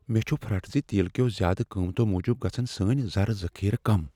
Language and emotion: Kashmiri, fearful